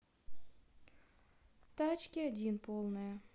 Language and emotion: Russian, neutral